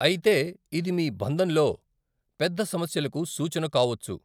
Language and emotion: Telugu, neutral